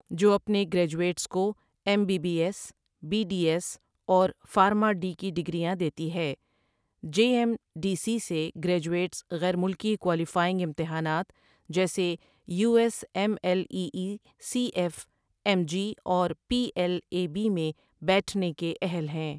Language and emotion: Urdu, neutral